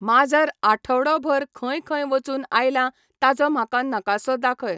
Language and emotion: Goan Konkani, neutral